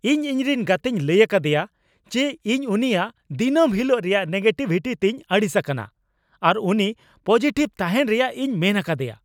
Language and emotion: Santali, angry